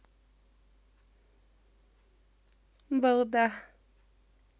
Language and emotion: Russian, positive